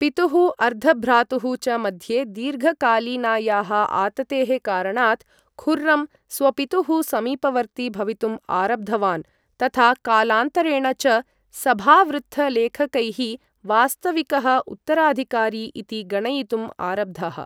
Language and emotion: Sanskrit, neutral